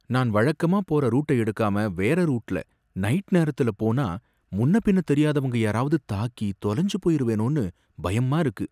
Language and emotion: Tamil, fearful